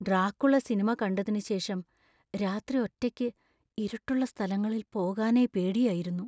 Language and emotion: Malayalam, fearful